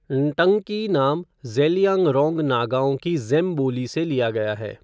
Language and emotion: Hindi, neutral